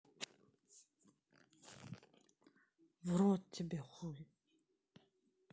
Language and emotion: Russian, neutral